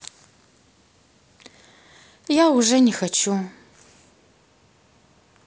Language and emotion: Russian, sad